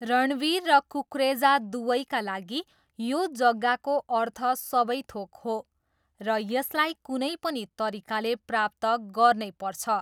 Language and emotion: Nepali, neutral